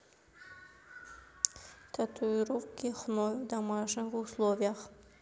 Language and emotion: Russian, neutral